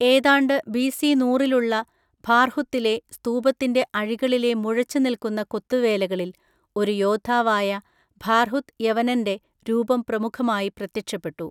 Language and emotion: Malayalam, neutral